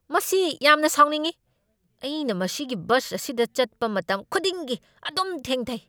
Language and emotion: Manipuri, angry